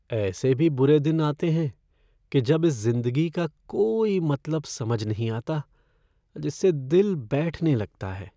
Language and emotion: Hindi, sad